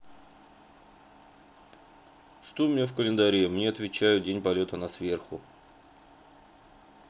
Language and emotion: Russian, neutral